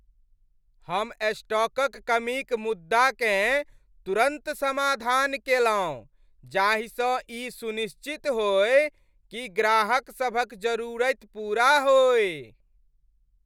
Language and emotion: Maithili, happy